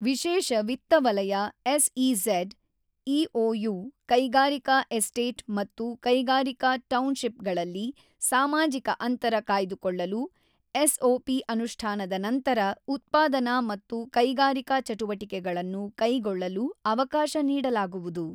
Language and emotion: Kannada, neutral